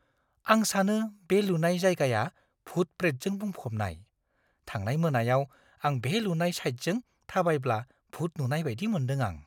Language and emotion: Bodo, fearful